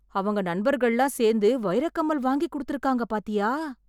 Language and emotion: Tamil, surprised